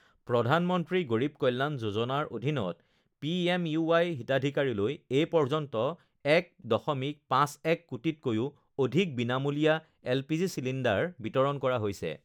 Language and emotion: Assamese, neutral